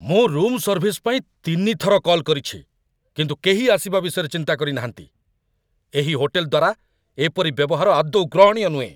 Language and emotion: Odia, angry